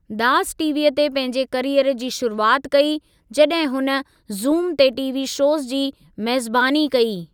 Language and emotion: Sindhi, neutral